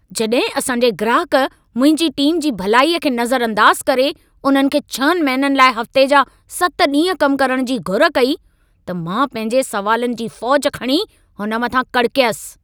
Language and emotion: Sindhi, angry